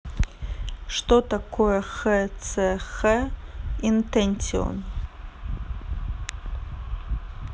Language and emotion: Russian, neutral